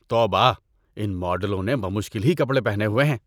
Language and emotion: Urdu, disgusted